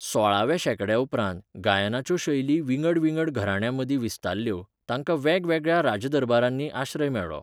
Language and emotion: Goan Konkani, neutral